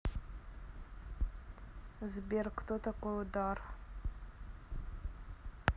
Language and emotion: Russian, neutral